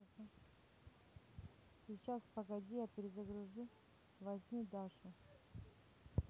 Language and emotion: Russian, neutral